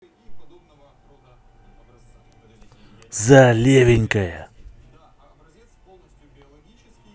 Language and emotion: Russian, angry